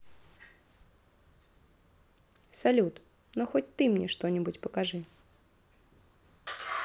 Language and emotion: Russian, positive